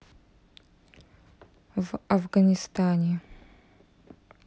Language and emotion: Russian, neutral